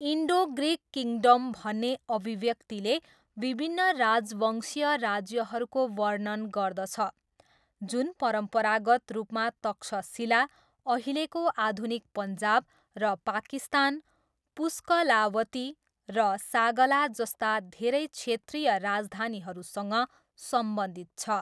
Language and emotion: Nepali, neutral